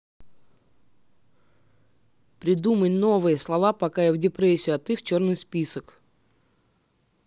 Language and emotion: Russian, angry